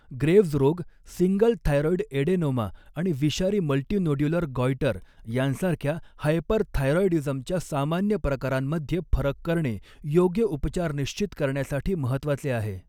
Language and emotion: Marathi, neutral